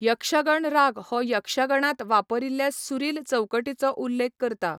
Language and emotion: Goan Konkani, neutral